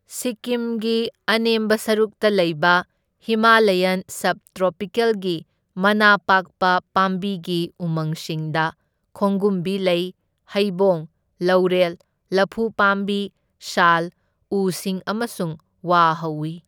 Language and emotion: Manipuri, neutral